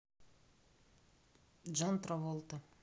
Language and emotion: Russian, neutral